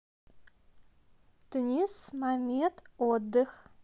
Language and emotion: Russian, neutral